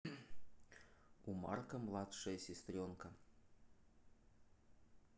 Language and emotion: Russian, neutral